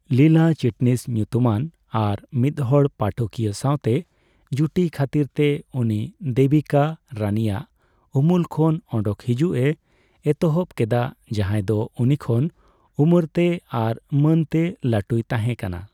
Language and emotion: Santali, neutral